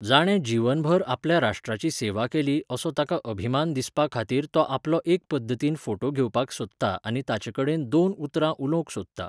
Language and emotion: Goan Konkani, neutral